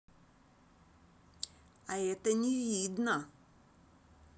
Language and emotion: Russian, neutral